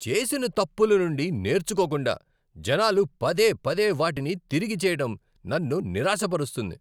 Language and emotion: Telugu, angry